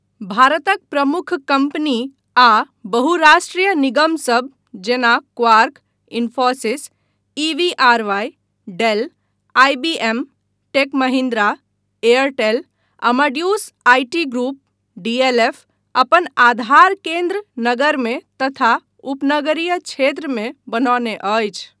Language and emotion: Maithili, neutral